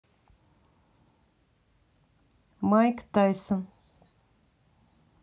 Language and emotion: Russian, neutral